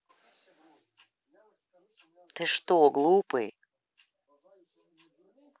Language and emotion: Russian, angry